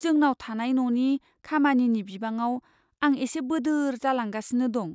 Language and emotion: Bodo, fearful